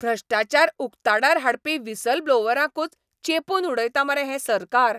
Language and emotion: Goan Konkani, angry